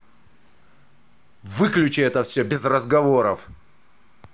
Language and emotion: Russian, angry